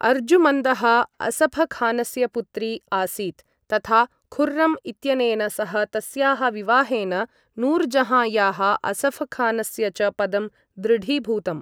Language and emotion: Sanskrit, neutral